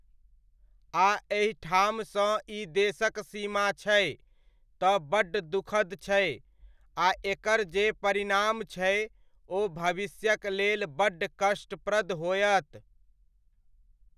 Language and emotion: Maithili, neutral